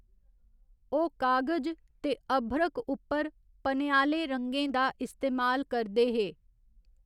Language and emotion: Dogri, neutral